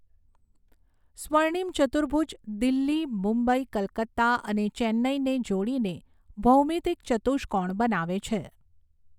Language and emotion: Gujarati, neutral